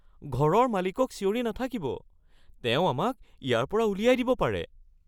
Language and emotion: Assamese, fearful